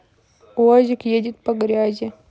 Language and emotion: Russian, neutral